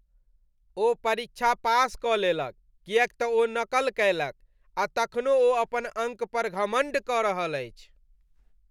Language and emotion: Maithili, disgusted